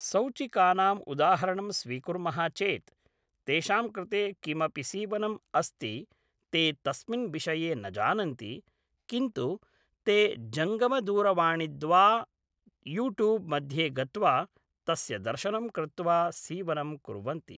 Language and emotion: Sanskrit, neutral